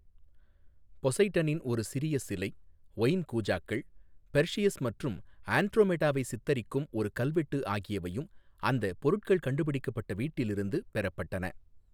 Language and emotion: Tamil, neutral